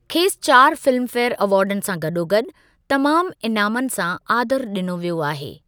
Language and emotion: Sindhi, neutral